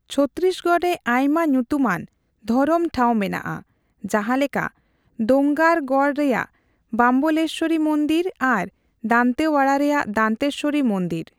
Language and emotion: Santali, neutral